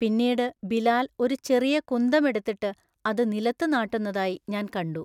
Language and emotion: Malayalam, neutral